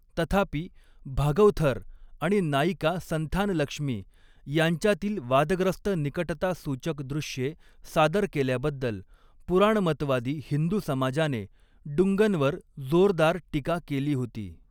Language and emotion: Marathi, neutral